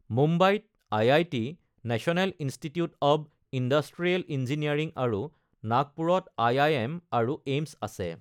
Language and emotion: Assamese, neutral